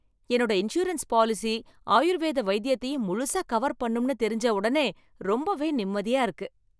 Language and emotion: Tamil, happy